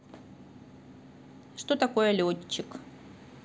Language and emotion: Russian, neutral